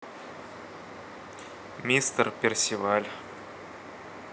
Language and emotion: Russian, neutral